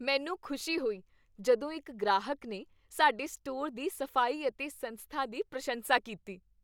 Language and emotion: Punjabi, happy